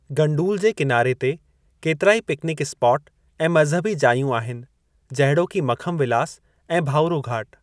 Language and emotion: Sindhi, neutral